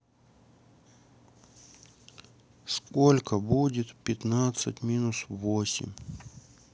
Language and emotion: Russian, sad